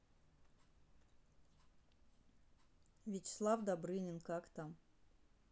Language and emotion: Russian, neutral